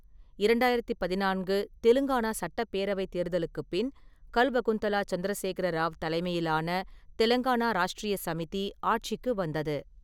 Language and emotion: Tamil, neutral